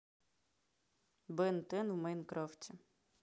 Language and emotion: Russian, neutral